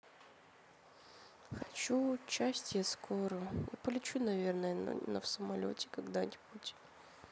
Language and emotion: Russian, sad